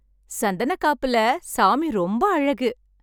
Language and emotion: Tamil, happy